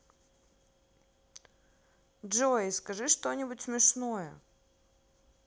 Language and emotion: Russian, neutral